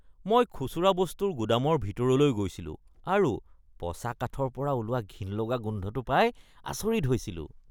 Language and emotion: Assamese, disgusted